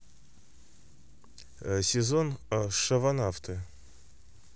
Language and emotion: Russian, neutral